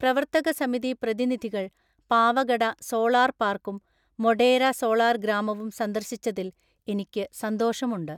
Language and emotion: Malayalam, neutral